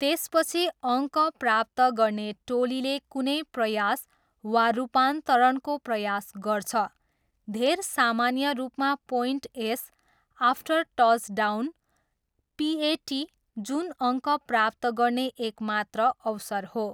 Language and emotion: Nepali, neutral